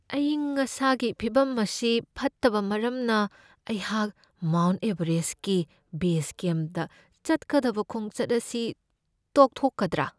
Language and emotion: Manipuri, fearful